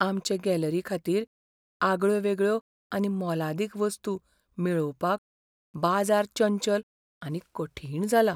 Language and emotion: Goan Konkani, fearful